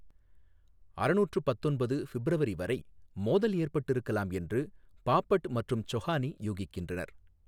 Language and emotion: Tamil, neutral